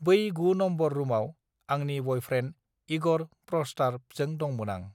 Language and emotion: Bodo, neutral